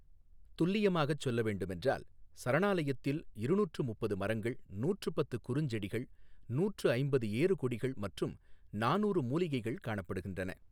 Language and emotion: Tamil, neutral